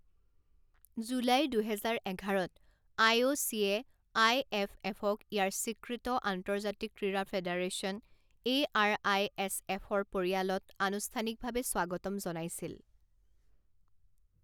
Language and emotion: Assamese, neutral